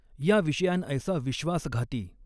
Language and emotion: Marathi, neutral